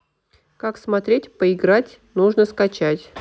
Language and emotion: Russian, neutral